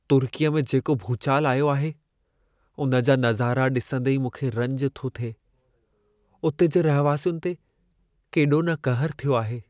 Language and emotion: Sindhi, sad